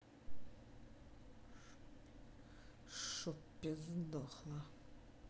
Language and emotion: Russian, angry